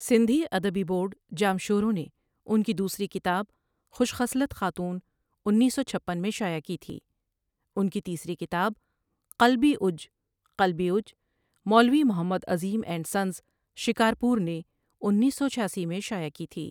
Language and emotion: Urdu, neutral